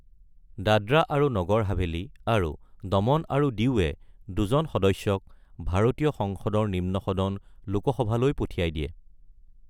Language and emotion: Assamese, neutral